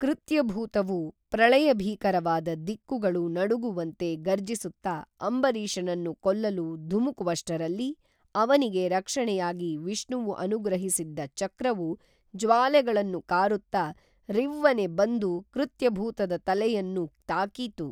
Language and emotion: Kannada, neutral